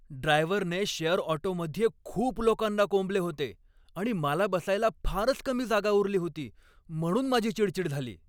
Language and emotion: Marathi, angry